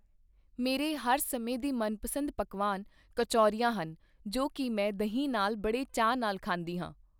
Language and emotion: Punjabi, neutral